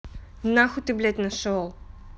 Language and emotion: Russian, angry